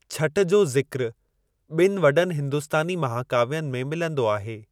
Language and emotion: Sindhi, neutral